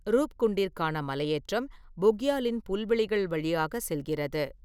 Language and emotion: Tamil, neutral